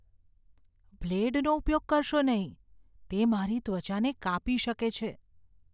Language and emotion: Gujarati, fearful